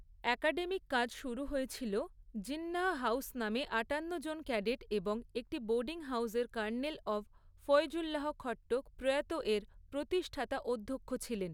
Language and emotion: Bengali, neutral